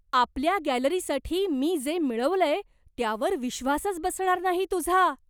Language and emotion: Marathi, surprised